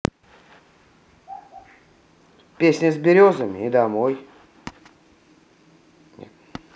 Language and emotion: Russian, neutral